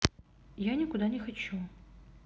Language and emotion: Russian, sad